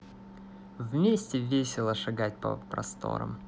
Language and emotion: Russian, positive